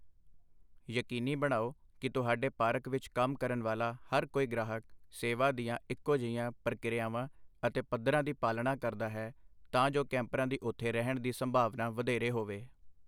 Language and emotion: Punjabi, neutral